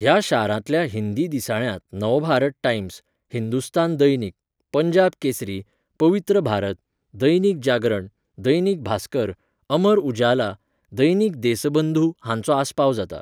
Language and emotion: Goan Konkani, neutral